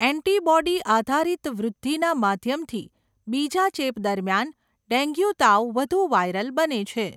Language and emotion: Gujarati, neutral